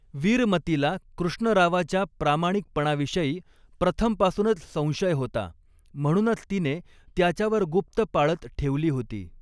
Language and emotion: Marathi, neutral